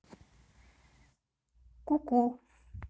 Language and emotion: Russian, neutral